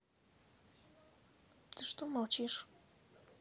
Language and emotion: Russian, sad